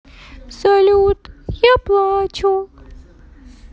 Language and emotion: Russian, sad